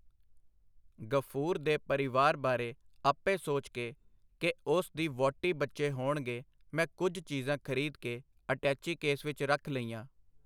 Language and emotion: Punjabi, neutral